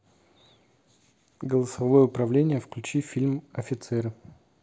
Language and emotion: Russian, neutral